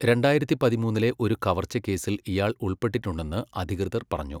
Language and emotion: Malayalam, neutral